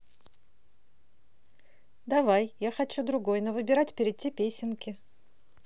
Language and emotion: Russian, positive